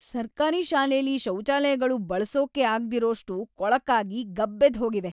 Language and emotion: Kannada, disgusted